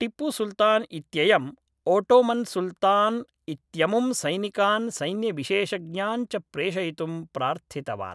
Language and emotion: Sanskrit, neutral